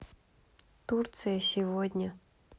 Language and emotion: Russian, neutral